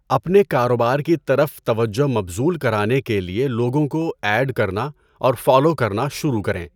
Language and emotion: Urdu, neutral